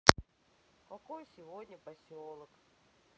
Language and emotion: Russian, sad